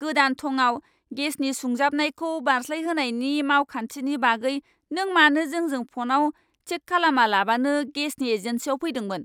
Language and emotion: Bodo, angry